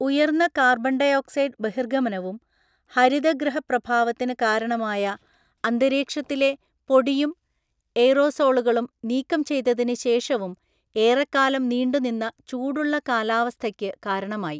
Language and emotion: Malayalam, neutral